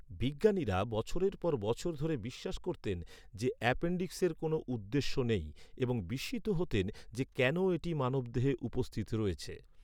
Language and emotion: Bengali, neutral